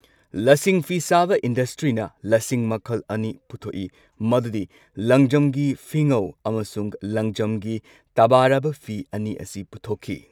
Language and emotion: Manipuri, neutral